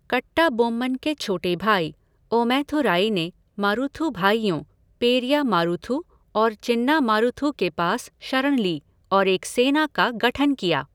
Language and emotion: Hindi, neutral